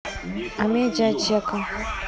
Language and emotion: Russian, neutral